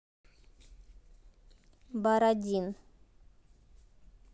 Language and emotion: Russian, neutral